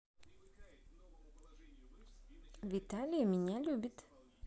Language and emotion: Russian, positive